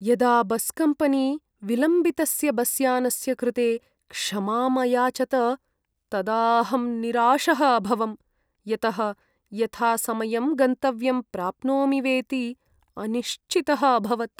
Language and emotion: Sanskrit, sad